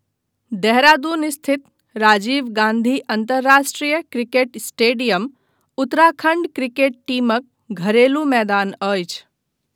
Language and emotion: Maithili, neutral